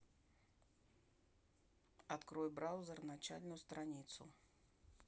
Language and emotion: Russian, neutral